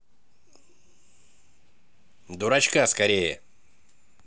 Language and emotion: Russian, angry